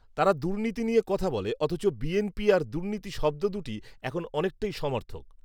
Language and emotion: Bengali, neutral